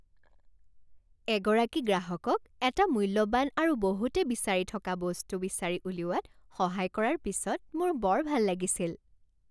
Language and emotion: Assamese, happy